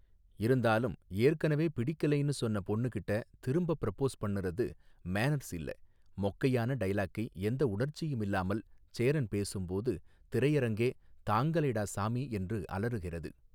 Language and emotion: Tamil, neutral